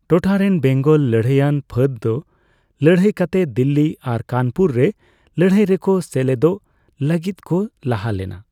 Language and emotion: Santali, neutral